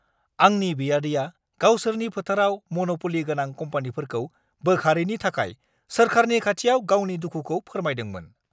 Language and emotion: Bodo, angry